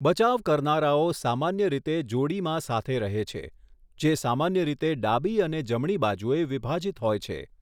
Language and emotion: Gujarati, neutral